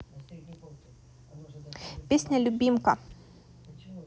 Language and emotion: Russian, neutral